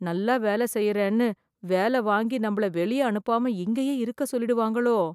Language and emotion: Tamil, fearful